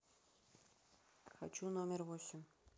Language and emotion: Russian, neutral